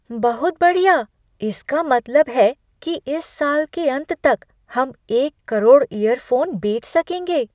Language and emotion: Hindi, surprised